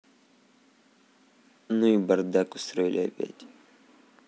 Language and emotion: Russian, neutral